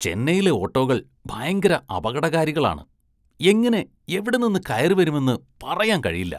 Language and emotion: Malayalam, disgusted